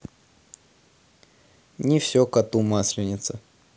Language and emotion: Russian, neutral